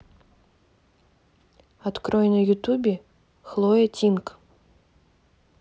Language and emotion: Russian, neutral